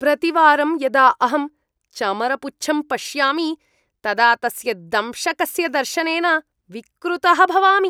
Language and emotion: Sanskrit, disgusted